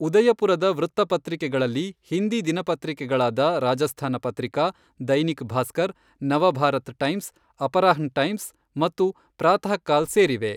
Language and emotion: Kannada, neutral